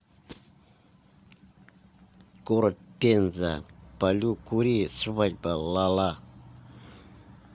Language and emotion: Russian, angry